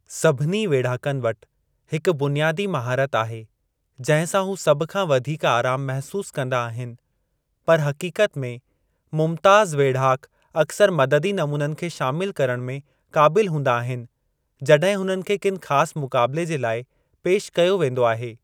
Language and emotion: Sindhi, neutral